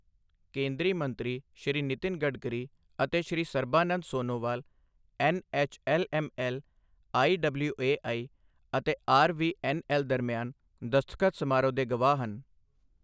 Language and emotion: Punjabi, neutral